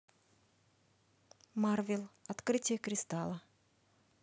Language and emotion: Russian, neutral